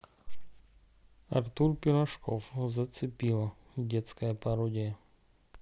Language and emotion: Russian, neutral